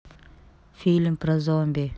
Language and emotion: Russian, neutral